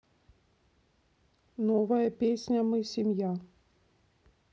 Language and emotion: Russian, neutral